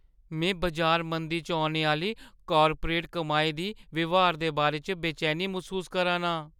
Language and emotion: Dogri, fearful